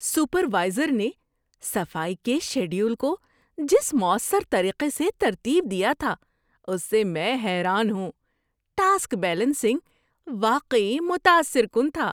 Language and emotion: Urdu, surprised